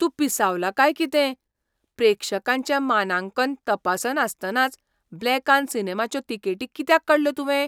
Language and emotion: Goan Konkani, surprised